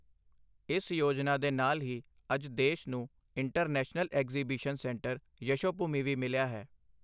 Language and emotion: Punjabi, neutral